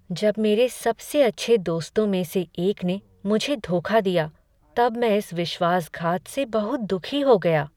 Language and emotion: Hindi, sad